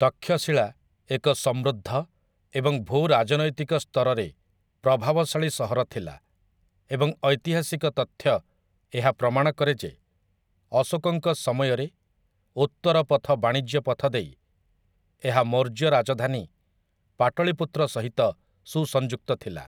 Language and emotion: Odia, neutral